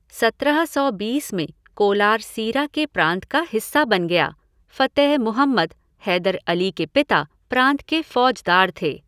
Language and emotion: Hindi, neutral